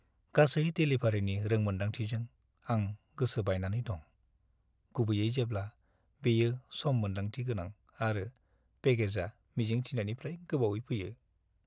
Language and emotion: Bodo, sad